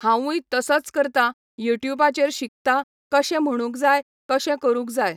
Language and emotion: Goan Konkani, neutral